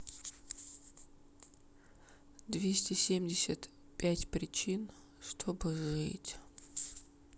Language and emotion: Russian, sad